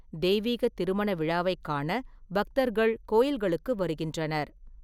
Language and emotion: Tamil, neutral